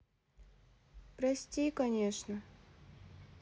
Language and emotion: Russian, sad